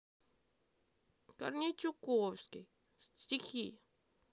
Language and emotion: Russian, sad